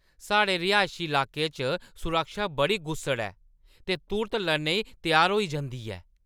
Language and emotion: Dogri, angry